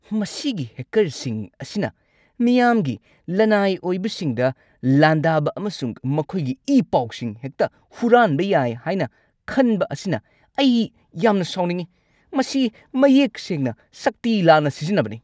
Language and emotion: Manipuri, angry